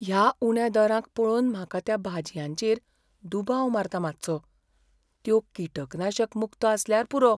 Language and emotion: Goan Konkani, fearful